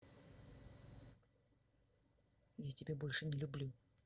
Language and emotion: Russian, angry